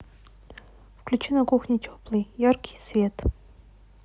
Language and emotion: Russian, neutral